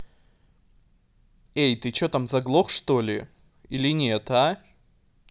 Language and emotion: Russian, angry